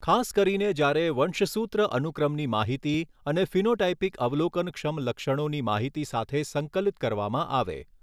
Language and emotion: Gujarati, neutral